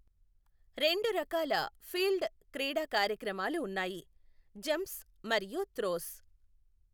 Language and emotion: Telugu, neutral